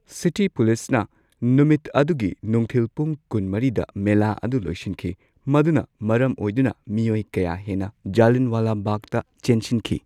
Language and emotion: Manipuri, neutral